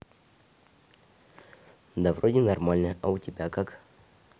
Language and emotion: Russian, neutral